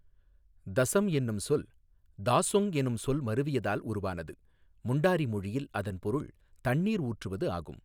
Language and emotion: Tamil, neutral